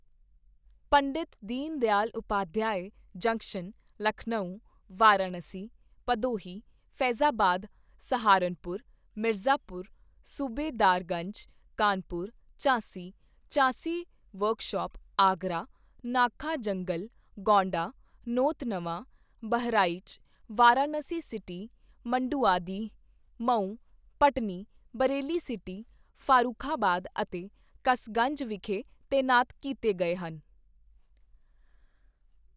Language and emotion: Punjabi, neutral